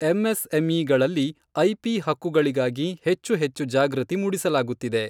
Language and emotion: Kannada, neutral